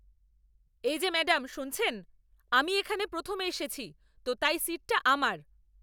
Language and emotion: Bengali, angry